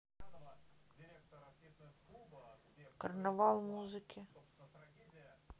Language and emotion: Russian, neutral